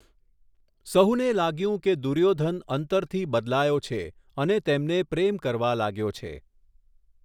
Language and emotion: Gujarati, neutral